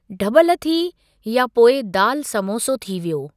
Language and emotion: Sindhi, neutral